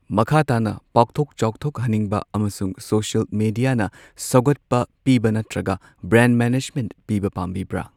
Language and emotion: Manipuri, neutral